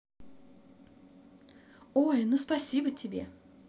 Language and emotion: Russian, positive